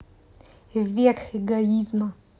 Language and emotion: Russian, neutral